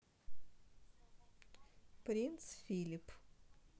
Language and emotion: Russian, neutral